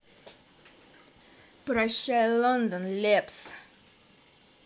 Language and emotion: Russian, positive